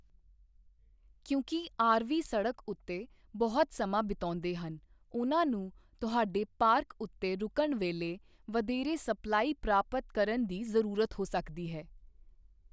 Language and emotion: Punjabi, neutral